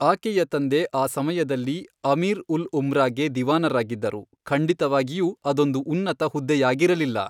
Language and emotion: Kannada, neutral